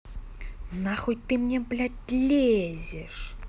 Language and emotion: Russian, angry